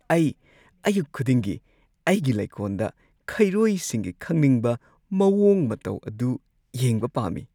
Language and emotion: Manipuri, happy